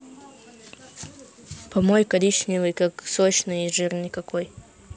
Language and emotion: Russian, neutral